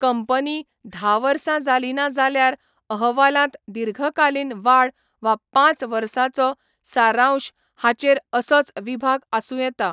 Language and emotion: Goan Konkani, neutral